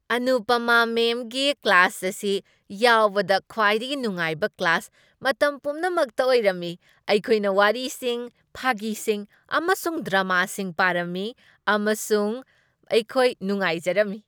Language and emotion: Manipuri, happy